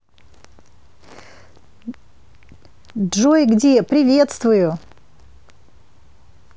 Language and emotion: Russian, positive